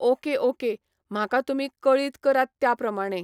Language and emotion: Goan Konkani, neutral